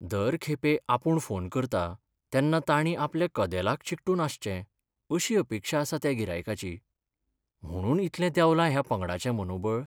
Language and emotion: Goan Konkani, sad